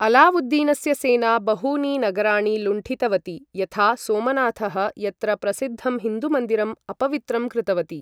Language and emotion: Sanskrit, neutral